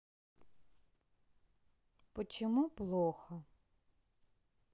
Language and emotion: Russian, sad